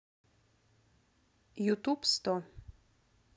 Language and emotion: Russian, neutral